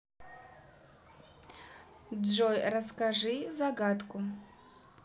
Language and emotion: Russian, neutral